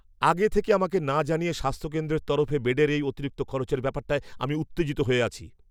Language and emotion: Bengali, angry